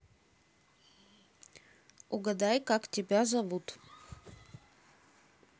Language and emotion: Russian, neutral